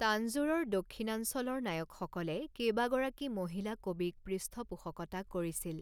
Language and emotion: Assamese, neutral